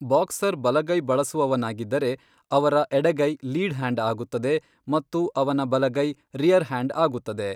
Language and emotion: Kannada, neutral